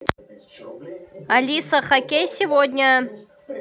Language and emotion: Russian, positive